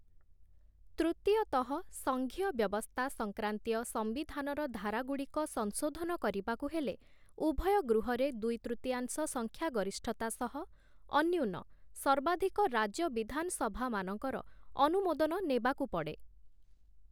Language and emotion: Odia, neutral